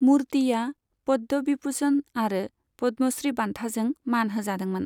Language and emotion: Bodo, neutral